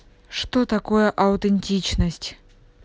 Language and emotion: Russian, neutral